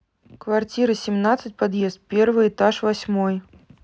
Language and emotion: Russian, neutral